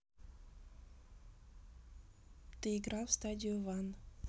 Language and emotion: Russian, neutral